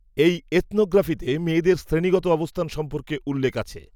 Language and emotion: Bengali, neutral